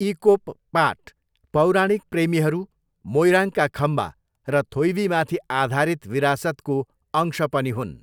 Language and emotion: Nepali, neutral